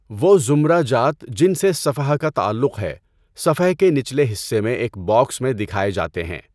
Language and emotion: Urdu, neutral